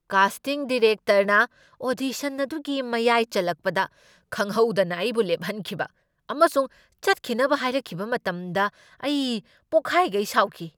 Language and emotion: Manipuri, angry